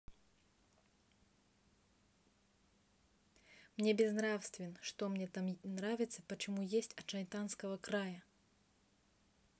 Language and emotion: Russian, neutral